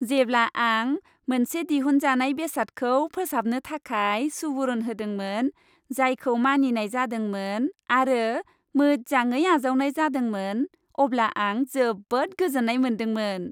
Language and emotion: Bodo, happy